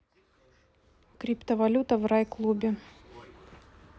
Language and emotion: Russian, neutral